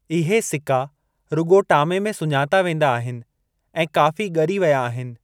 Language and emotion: Sindhi, neutral